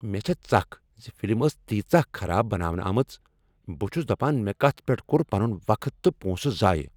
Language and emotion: Kashmiri, angry